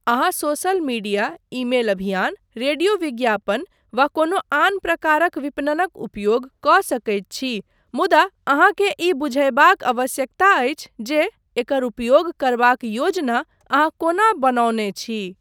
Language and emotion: Maithili, neutral